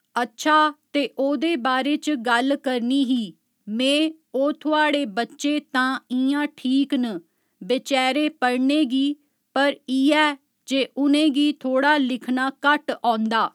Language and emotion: Dogri, neutral